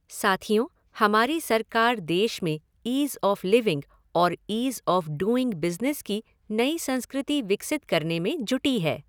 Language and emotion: Hindi, neutral